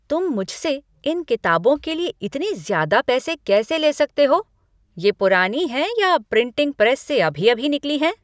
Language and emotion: Hindi, angry